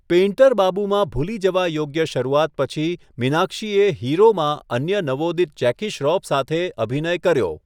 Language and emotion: Gujarati, neutral